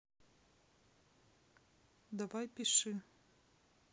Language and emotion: Russian, neutral